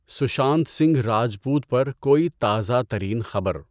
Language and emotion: Urdu, neutral